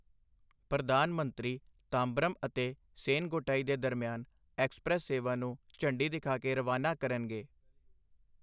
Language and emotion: Punjabi, neutral